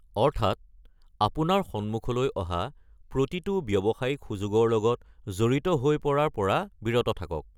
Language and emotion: Assamese, neutral